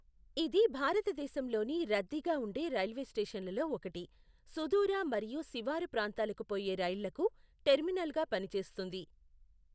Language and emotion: Telugu, neutral